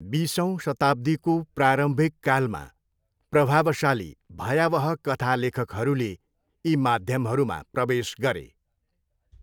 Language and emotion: Nepali, neutral